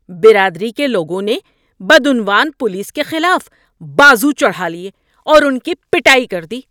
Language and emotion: Urdu, angry